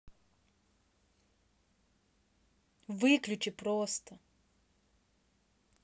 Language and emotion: Russian, angry